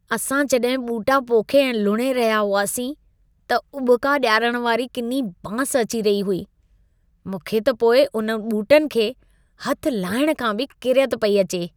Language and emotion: Sindhi, disgusted